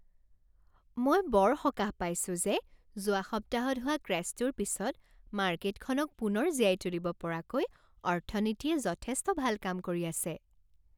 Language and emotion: Assamese, happy